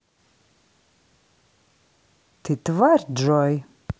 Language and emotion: Russian, neutral